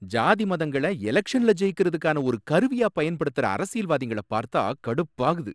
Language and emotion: Tamil, angry